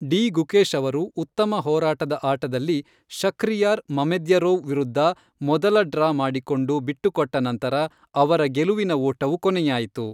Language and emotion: Kannada, neutral